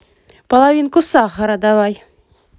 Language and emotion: Russian, positive